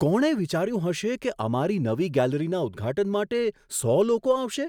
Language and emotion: Gujarati, surprised